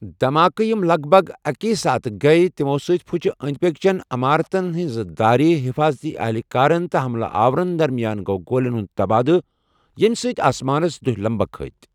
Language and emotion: Kashmiri, neutral